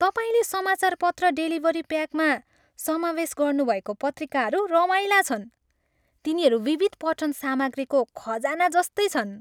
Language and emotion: Nepali, happy